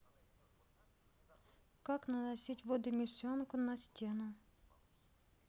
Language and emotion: Russian, neutral